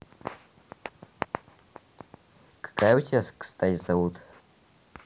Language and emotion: Russian, neutral